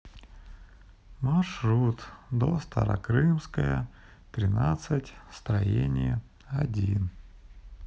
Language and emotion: Russian, sad